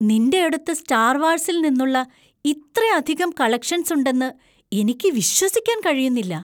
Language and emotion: Malayalam, surprised